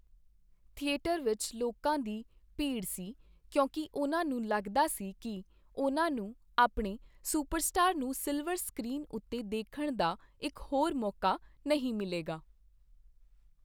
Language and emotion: Punjabi, neutral